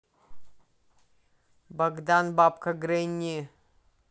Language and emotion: Russian, neutral